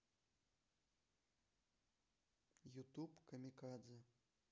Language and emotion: Russian, neutral